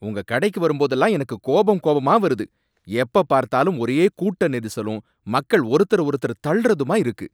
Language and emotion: Tamil, angry